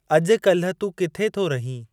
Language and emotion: Sindhi, neutral